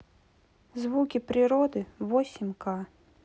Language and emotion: Russian, neutral